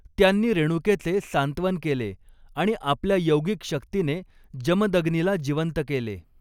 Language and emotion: Marathi, neutral